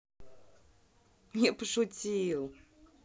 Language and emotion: Russian, positive